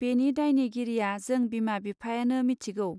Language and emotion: Bodo, neutral